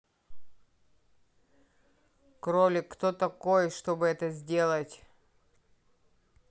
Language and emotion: Russian, neutral